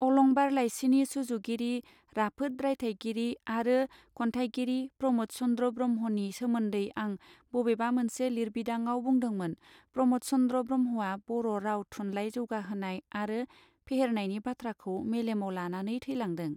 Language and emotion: Bodo, neutral